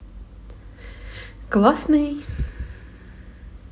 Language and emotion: Russian, positive